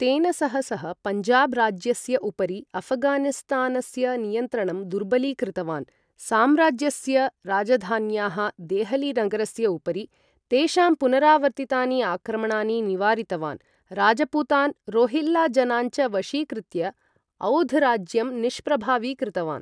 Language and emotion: Sanskrit, neutral